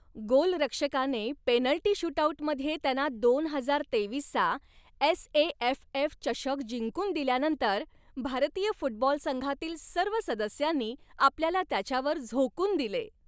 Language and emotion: Marathi, happy